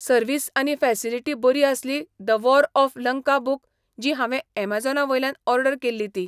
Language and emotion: Goan Konkani, neutral